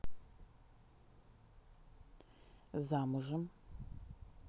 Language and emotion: Russian, neutral